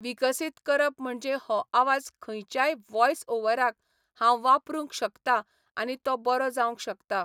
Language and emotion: Goan Konkani, neutral